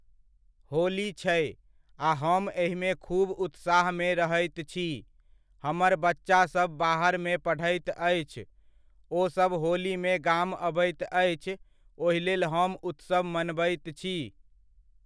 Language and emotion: Maithili, neutral